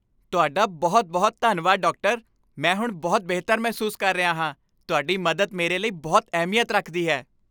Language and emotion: Punjabi, happy